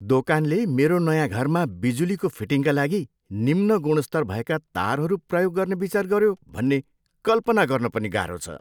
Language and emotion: Nepali, disgusted